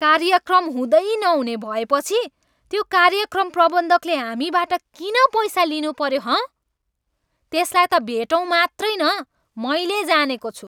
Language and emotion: Nepali, angry